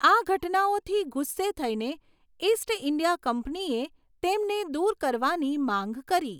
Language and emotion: Gujarati, neutral